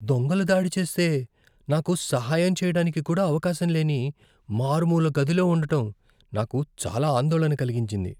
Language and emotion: Telugu, fearful